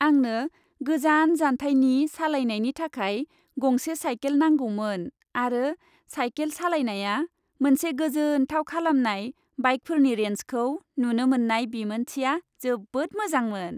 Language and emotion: Bodo, happy